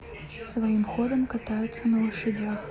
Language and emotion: Russian, neutral